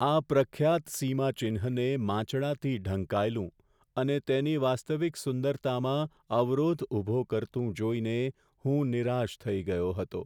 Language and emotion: Gujarati, sad